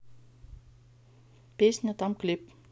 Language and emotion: Russian, neutral